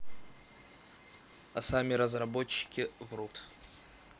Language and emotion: Russian, neutral